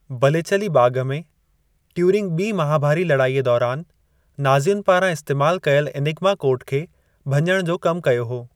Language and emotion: Sindhi, neutral